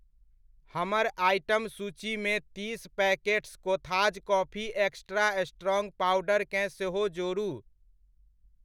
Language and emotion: Maithili, neutral